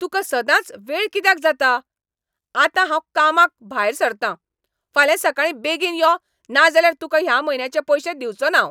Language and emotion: Goan Konkani, angry